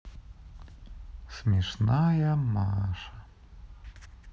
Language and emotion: Russian, sad